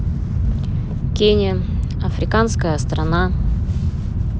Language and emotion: Russian, neutral